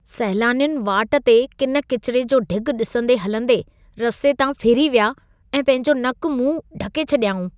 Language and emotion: Sindhi, disgusted